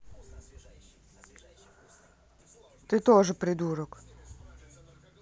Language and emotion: Russian, angry